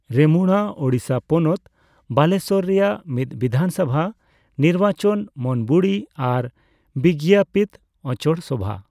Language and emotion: Santali, neutral